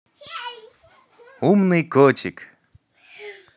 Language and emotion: Russian, positive